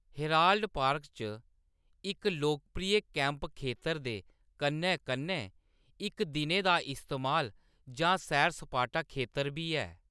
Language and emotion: Dogri, neutral